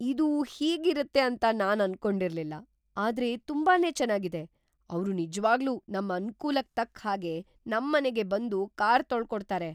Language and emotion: Kannada, surprised